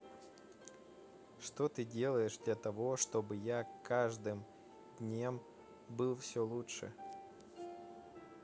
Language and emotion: Russian, neutral